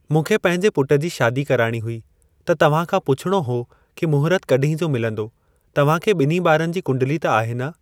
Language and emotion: Sindhi, neutral